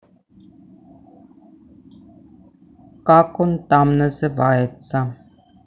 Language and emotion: Russian, neutral